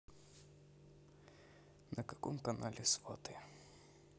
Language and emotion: Russian, neutral